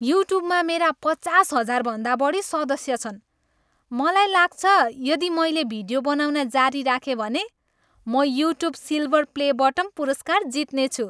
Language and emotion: Nepali, happy